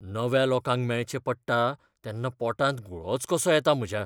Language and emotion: Goan Konkani, fearful